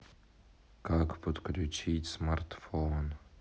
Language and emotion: Russian, sad